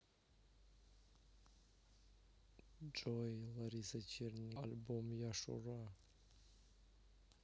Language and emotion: Russian, neutral